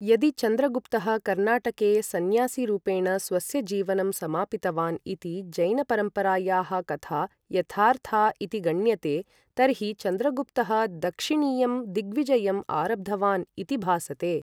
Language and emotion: Sanskrit, neutral